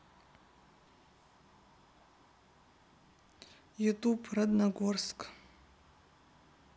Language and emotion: Russian, neutral